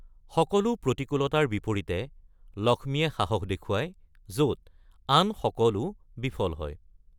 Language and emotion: Assamese, neutral